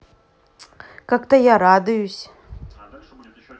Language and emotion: Russian, neutral